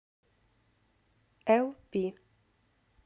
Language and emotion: Russian, neutral